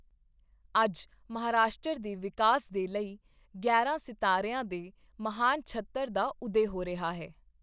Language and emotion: Punjabi, neutral